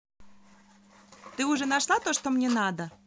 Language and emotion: Russian, positive